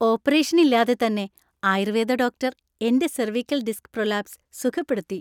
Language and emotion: Malayalam, happy